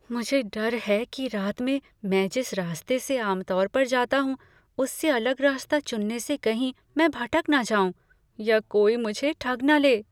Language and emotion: Hindi, fearful